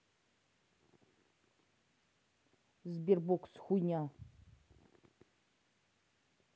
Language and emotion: Russian, angry